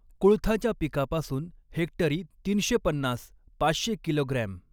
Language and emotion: Marathi, neutral